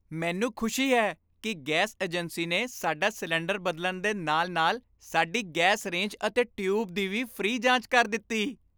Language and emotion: Punjabi, happy